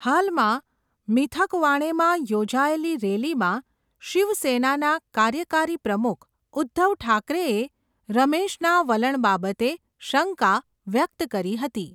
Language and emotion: Gujarati, neutral